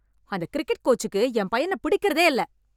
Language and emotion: Tamil, angry